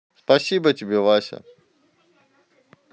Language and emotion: Russian, neutral